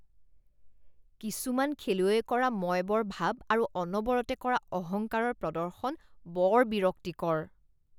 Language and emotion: Assamese, disgusted